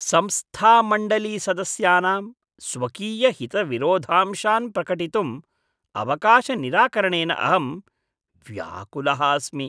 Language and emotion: Sanskrit, disgusted